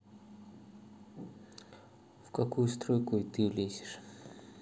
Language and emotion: Russian, neutral